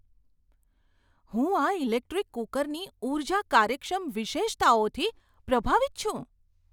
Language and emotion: Gujarati, surprised